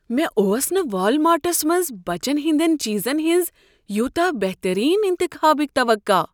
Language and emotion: Kashmiri, surprised